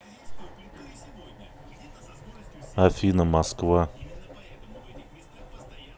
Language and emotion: Russian, neutral